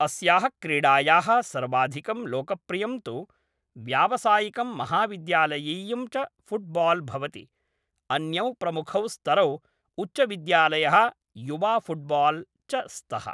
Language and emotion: Sanskrit, neutral